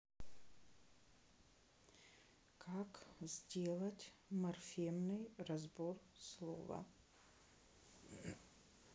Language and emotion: Russian, neutral